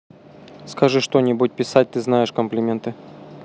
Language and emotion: Russian, neutral